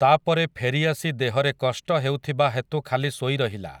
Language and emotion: Odia, neutral